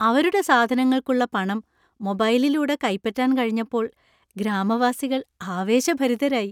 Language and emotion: Malayalam, happy